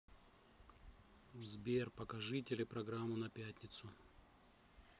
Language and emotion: Russian, neutral